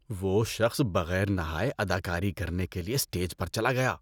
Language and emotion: Urdu, disgusted